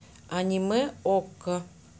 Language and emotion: Russian, neutral